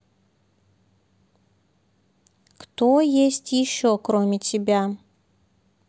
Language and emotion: Russian, neutral